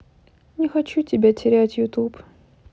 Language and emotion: Russian, sad